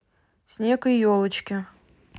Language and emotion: Russian, neutral